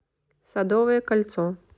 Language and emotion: Russian, neutral